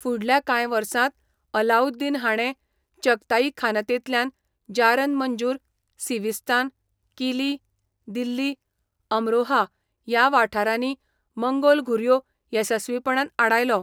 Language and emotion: Goan Konkani, neutral